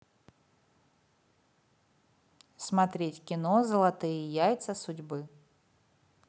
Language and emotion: Russian, positive